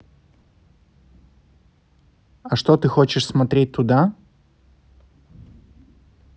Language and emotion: Russian, neutral